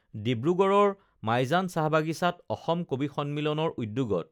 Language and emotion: Assamese, neutral